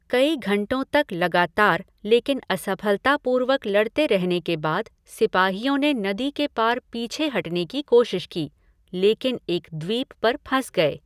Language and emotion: Hindi, neutral